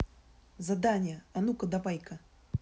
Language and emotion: Russian, angry